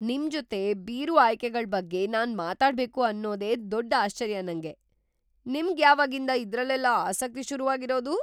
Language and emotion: Kannada, surprised